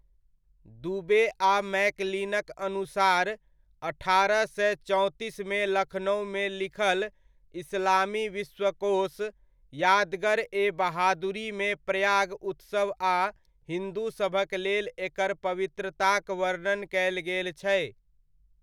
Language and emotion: Maithili, neutral